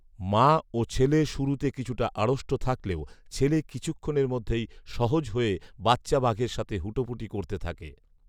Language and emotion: Bengali, neutral